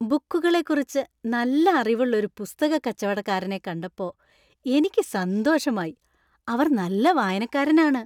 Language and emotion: Malayalam, happy